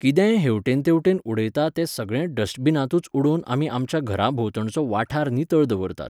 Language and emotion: Goan Konkani, neutral